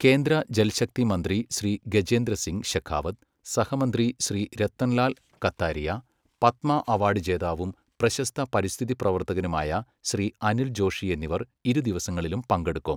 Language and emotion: Malayalam, neutral